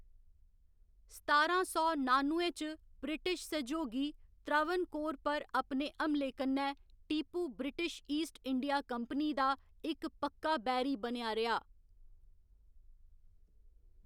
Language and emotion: Dogri, neutral